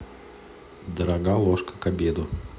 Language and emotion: Russian, neutral